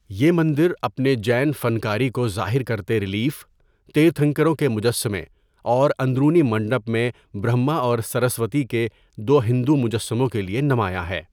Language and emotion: Urdu, neutral